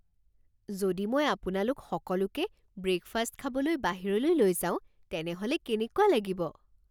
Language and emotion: Assamese, surprised